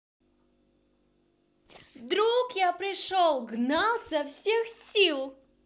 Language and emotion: Russian, positive